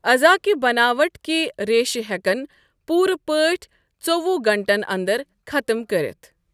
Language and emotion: Kashmiri, neutral